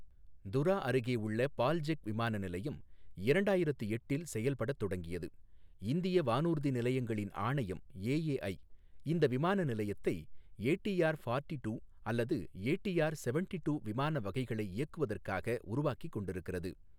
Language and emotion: Tamil, neutral